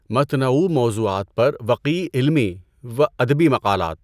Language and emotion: Urdu, neutral